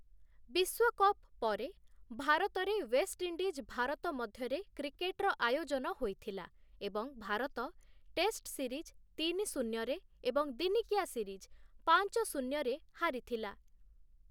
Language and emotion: Odia, neutral